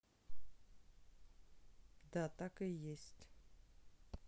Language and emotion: Russian, neutral